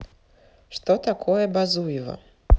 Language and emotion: Russian, neutral